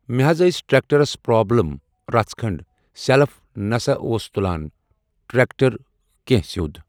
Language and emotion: Kashmiri, neutral